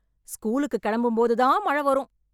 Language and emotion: Tamil, angry